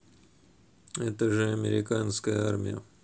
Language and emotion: Russian, neutral